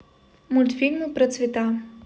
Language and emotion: Russian, neutral